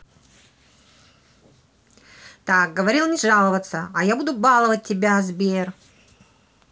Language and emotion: Russian, angry